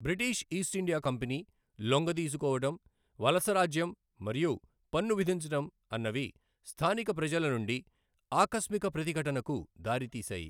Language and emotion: Telugu, neutral